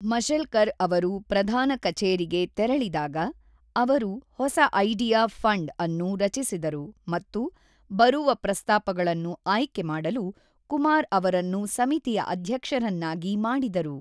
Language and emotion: Kannada, neutral